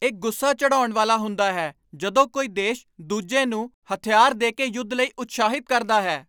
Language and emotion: Punjabi, angry